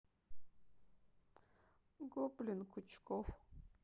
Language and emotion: Russian, sad